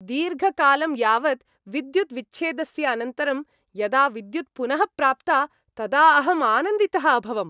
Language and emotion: Sanskrit, happy